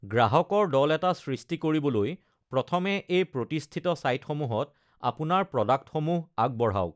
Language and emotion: Assamese, neutral